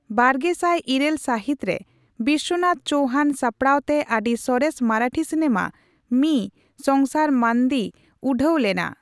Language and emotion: Santali, neutral